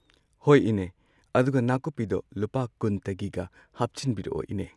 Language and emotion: Manipuri, neutral